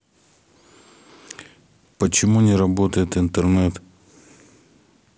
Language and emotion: Russian, neutral